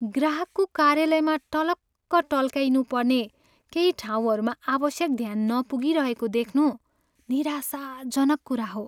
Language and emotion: Nepali, sad